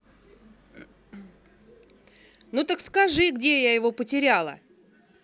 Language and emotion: Russian, angry